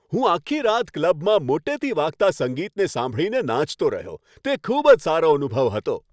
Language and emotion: Gujarati, happy